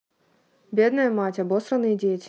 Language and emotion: Russian, neutral